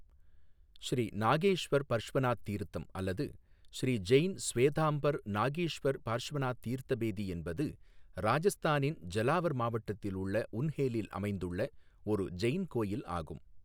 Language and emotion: Tamil, neutral